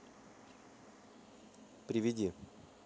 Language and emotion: Russian, neutral